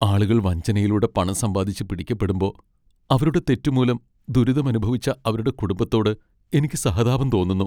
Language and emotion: Malayalam, sad